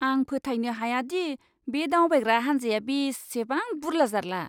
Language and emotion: Bodo, disgusted